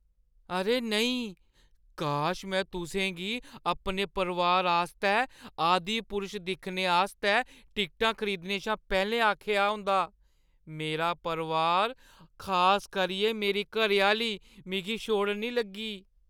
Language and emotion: Dogri, fearful